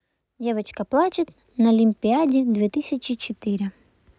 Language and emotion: Russian, neutral